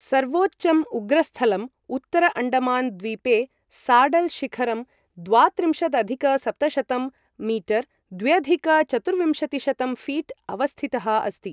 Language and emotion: Sanskrit, neutral